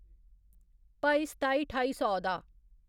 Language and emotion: Dogri, neutral